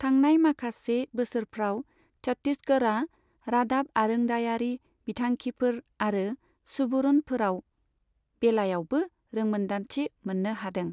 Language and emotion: Bodo, neutral